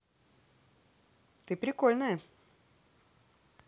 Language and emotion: Russian, positive